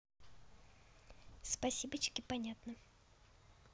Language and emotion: Russian, neutral